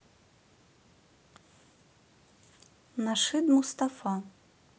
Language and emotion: Russian, neutral